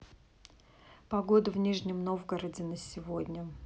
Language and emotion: Russian, neutral